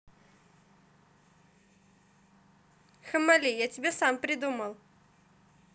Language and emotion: Russian, positive